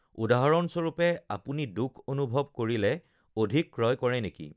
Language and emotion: Assamese, neutral